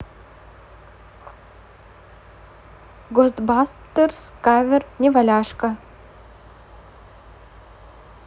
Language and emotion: Russian, neutral